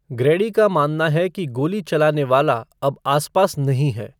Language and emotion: Hindi, neutral